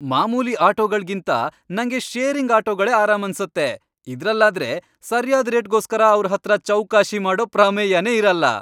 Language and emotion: Kannada, happy